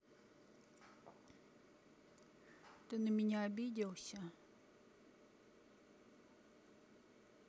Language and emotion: Russian, sad